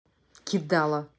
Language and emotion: Russian, angry